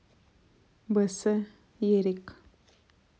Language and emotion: Russian, neutral